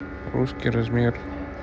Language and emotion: Russian, neutral